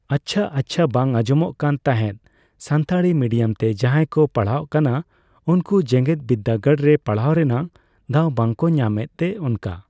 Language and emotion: Santali, neutral